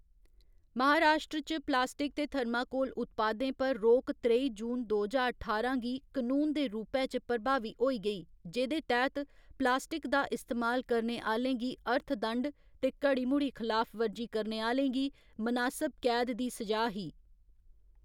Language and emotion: Dogri, neutral